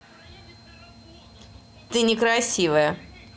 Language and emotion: Russian, neutral